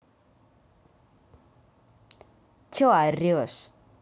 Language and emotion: Russian, angry